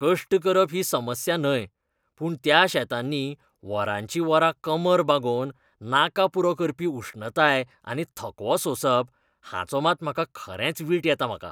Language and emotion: Goan Konkani, disgusted